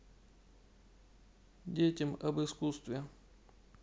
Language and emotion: Russian, neutral